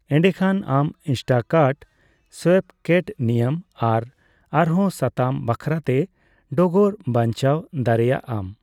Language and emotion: Santali, neutral